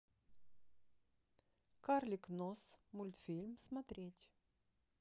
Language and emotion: Russian, neutral